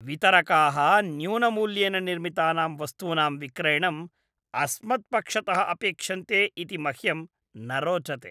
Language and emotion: Sanskrit, disgusted